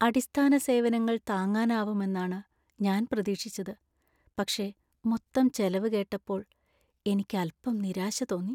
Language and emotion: Malayalam, sad